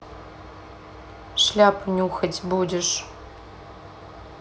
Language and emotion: Russian, neutral